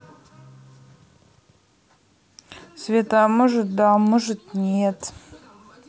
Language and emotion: Russian, neutral